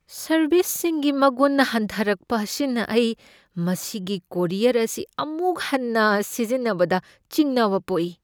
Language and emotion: Manipuri, fearful